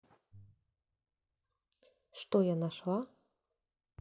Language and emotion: Russian, neutral